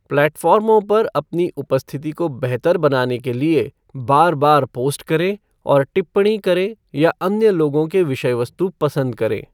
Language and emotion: Hindi, neutral